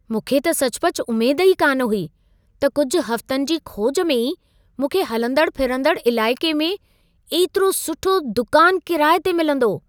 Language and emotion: Sindhi, surprised